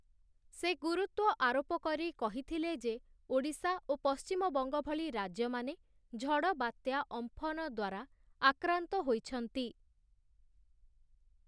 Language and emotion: Odia, neutral